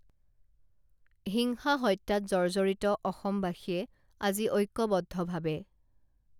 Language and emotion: Assamese, neutral